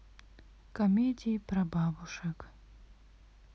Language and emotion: Russian, sad